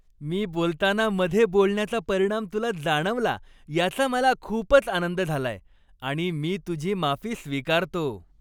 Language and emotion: Marathi, happy